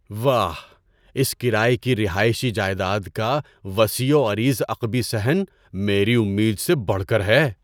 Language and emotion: Urdu, surprised